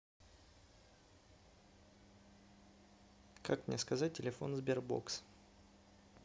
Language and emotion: Russian, neutral